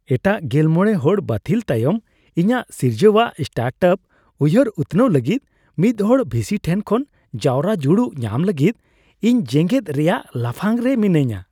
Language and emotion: Santali, happy